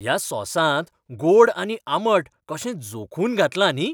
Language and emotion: Goan Konkani, happy